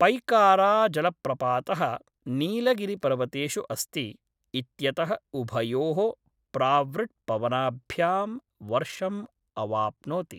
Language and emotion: Sanskrit, neutral